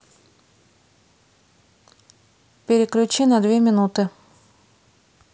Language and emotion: Russian, neutral